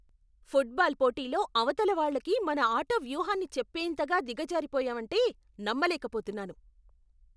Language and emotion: Telugu, angry